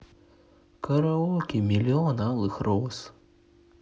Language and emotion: Russian, sad